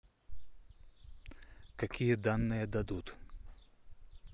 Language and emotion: Russian, neutral